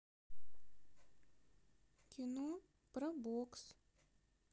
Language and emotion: Russian, neutral